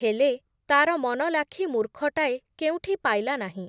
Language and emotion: Odia, neutral